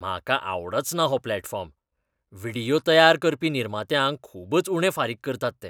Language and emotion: Goan Konkani, disgusted